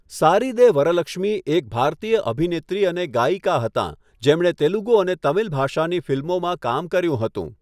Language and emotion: Gujarati, neutral